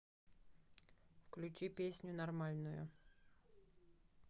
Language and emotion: Russian, neutral